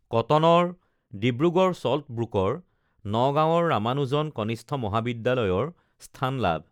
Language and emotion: Assamese, neutral